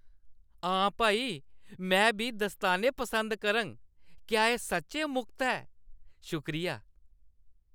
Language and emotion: Dogri, happy